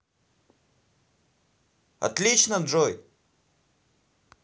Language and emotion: Russian, positive